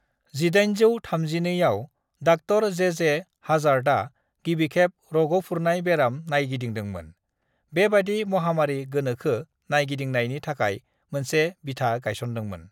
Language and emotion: Bodo, neutral